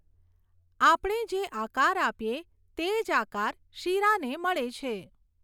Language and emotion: Gujarati, neutral